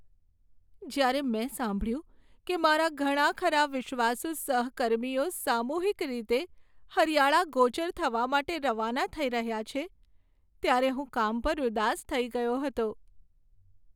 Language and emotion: Gujarati, sad